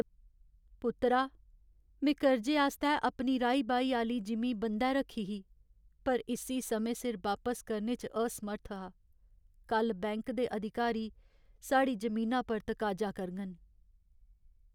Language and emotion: Dogri, sad